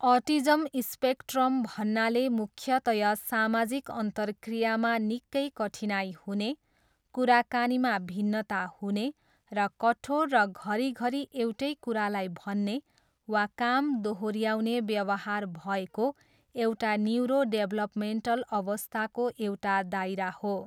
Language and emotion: Nepali, neutral